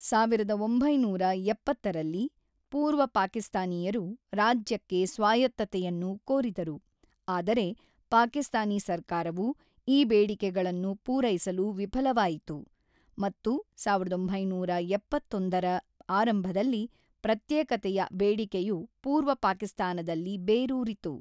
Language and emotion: Kannada, neutral